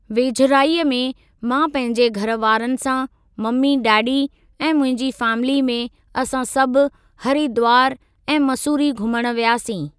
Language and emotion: Sindhi, neutral